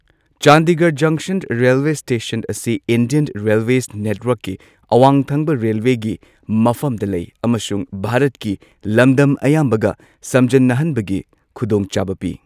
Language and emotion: Manipuri, neutral